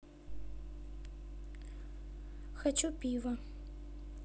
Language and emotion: Russian, neutral